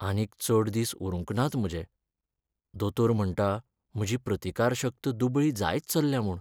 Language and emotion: Goan Konkani, sad